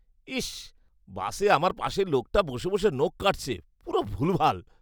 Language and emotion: Bengali, disgusted